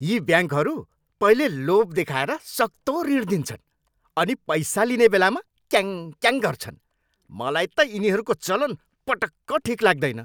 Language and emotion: Nepali, angry